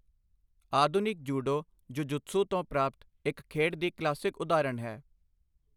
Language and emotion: Punjabi, neutral